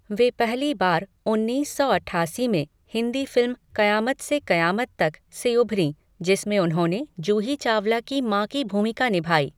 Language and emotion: Hindi, neutral